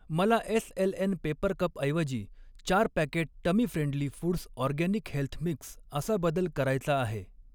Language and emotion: Marathi, neutral